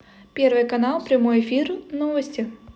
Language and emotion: Russian, neutral